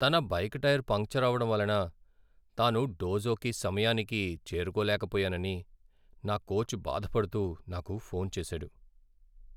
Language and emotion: Telugu, sad